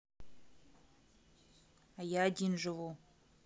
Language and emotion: Russian, neutral